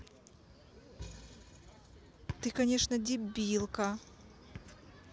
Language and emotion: Russian, angry